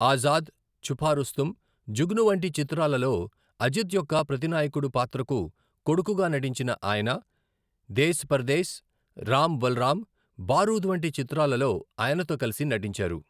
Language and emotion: Telugu, neutral